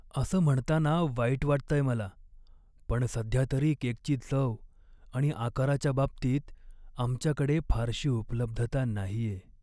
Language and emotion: Marathi, sad